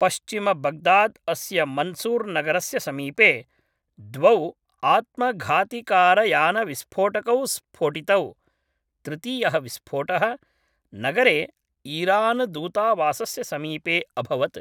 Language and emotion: Sanskrit, neutral